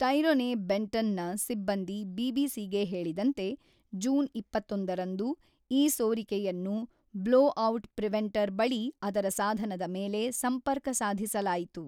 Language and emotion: Kannada, neutral